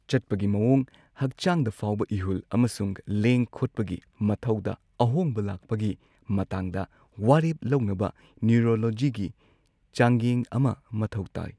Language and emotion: Manipuri, neutral